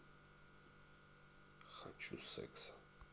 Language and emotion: Russian, neutral